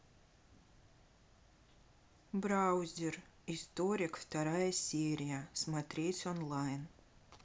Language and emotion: Russian, neutral